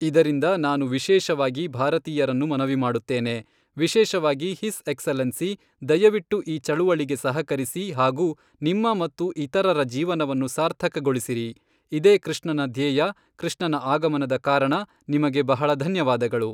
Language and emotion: Kannada, neutral